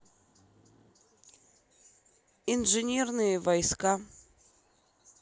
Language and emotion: Russian, neutral